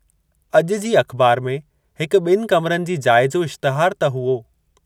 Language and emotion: Sindhi, neutral